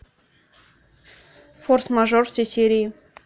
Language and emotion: Russian, neutral